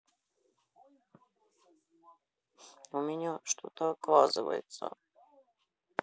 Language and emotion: Russian, sad